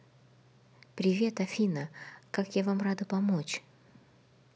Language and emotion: Russian, positive